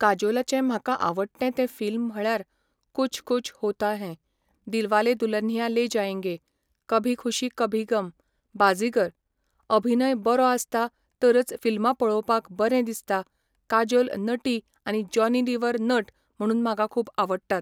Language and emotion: Goan Konkani, neutral